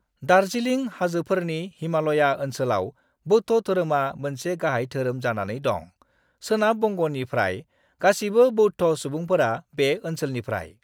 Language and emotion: Bodo, neutral